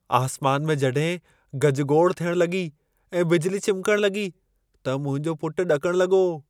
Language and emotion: Sindhi, fearful